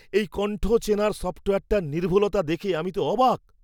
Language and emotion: Bengali, surprised